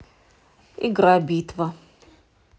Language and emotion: Russian, neutral